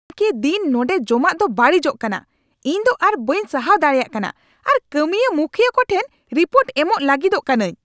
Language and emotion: Santali, angry